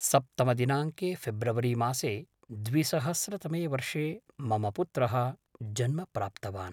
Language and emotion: Sanskrit, neutral